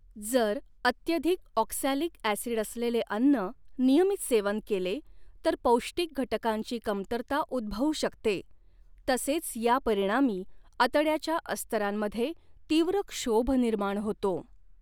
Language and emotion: Marathi, neutral